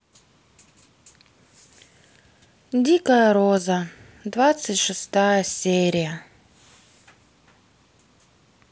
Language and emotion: Russian, sad